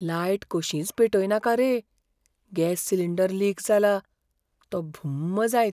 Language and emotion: Goan Konkani, fearful